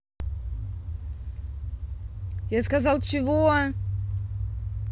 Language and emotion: Russian, angry